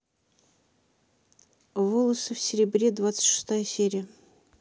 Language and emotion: Russian, neutral